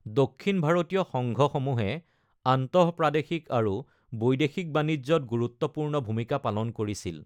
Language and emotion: Assamese, neutral